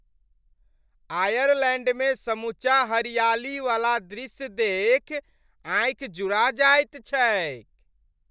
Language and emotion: Maithili, happy